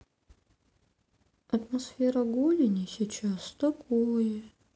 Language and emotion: Russian, sad